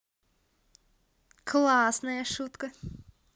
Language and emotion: Russian, positive